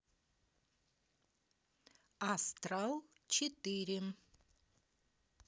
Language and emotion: Russian, neutral